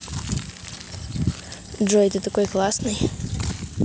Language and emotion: Russian, neutral